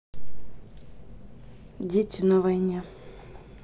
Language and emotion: Russian, neutral